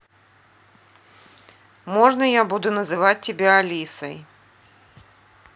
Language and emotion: Russian, neutral